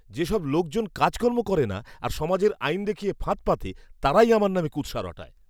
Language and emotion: Bengali, disgusted